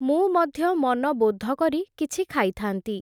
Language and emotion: Odia, neutral